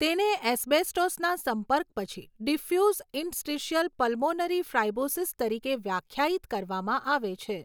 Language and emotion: Gujarati, neutral